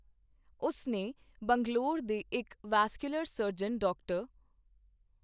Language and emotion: Punjabi, neutral